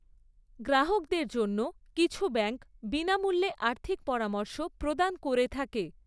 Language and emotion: Bengali, neutral